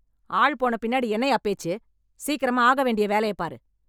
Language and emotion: Tamil, angry